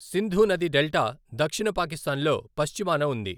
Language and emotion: Telugu, neutral